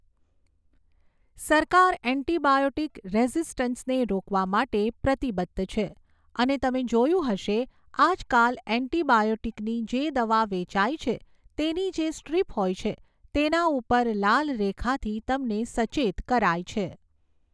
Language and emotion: Gujarati, neutral